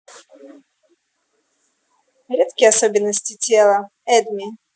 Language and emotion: Russian, neutral